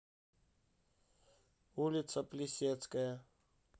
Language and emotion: Russian, neutral